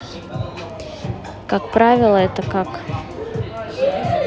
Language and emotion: Russian, neutral